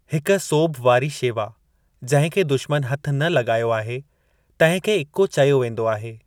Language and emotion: Sindhi, neutral